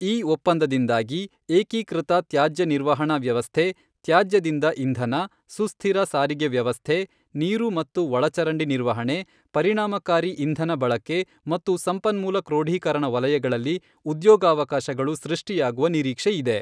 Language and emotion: Kannada, neutral